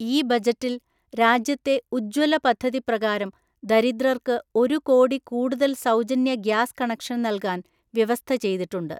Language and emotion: Malayalam, neutral